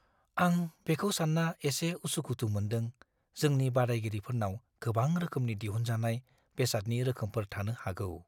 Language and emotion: Bodo, fearful